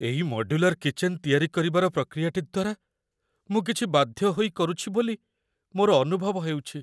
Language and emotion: Odia, fearful